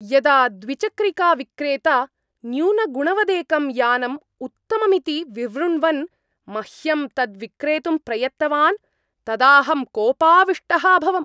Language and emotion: Sanskrit, angry